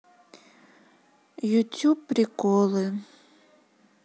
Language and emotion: Russian, neutral